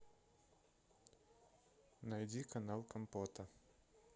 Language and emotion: Russian, neutral